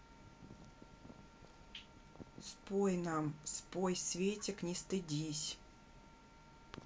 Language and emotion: Russian, neutral